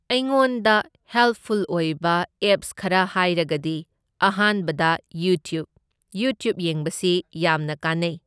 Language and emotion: Manipuri, neutral